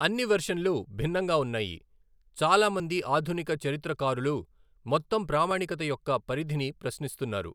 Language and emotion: Telugu, neutral